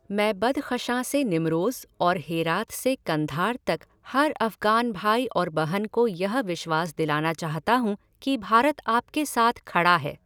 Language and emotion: Hindi, neutral